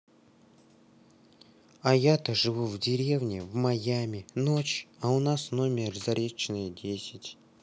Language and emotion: Russian, neutral